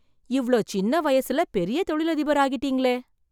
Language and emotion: Tamil, surprised